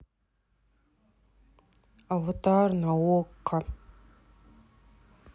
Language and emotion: Russian, sad